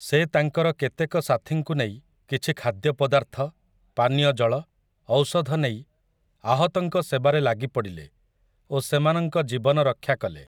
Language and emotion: Odia, neutral